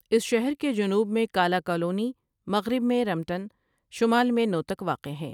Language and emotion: Urdu, neutral